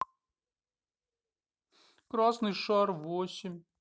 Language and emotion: Russian, sad